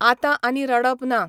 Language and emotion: Goan Konkani, neutral